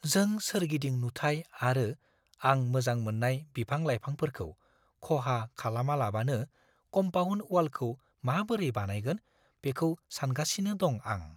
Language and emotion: Bodo, fearful